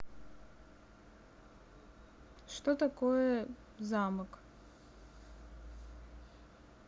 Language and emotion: Russian, neutral